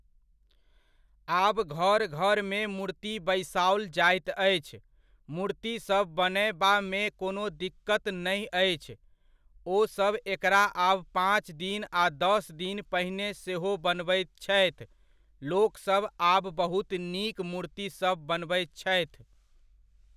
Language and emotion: Maithili, neutral